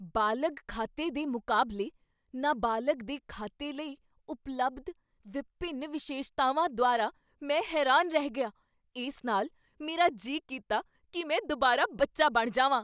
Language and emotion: Punjabi, surprised